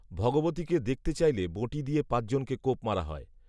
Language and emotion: Bengali, neutral